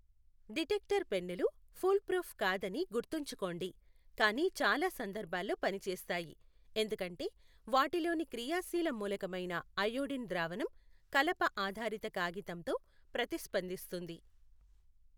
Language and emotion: Telugu, neutral